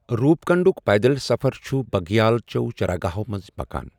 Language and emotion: Kashmiri, neutral